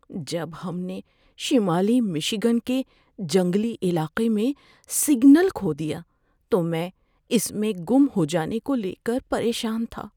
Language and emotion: Urdu, fearful